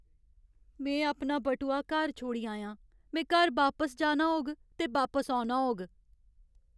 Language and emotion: Dogri, sad